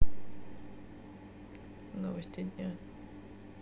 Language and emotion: Russian, neutral